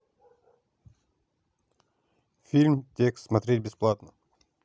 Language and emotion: Russian, neutral